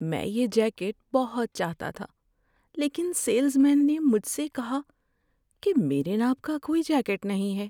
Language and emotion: Urdu, sad